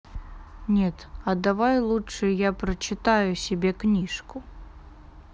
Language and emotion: Russian, neutral